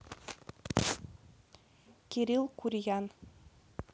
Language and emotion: Russian, neutral